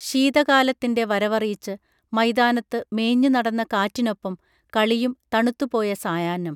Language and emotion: Malayalam, neutral